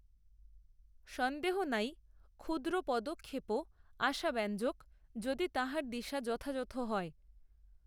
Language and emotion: Bengali, neutral